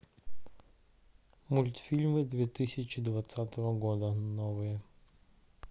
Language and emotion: Russian, neutral